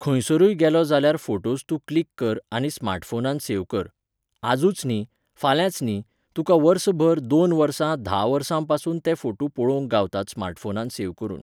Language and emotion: Goan Konkani, neutral